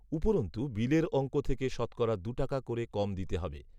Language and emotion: Bengali, neutral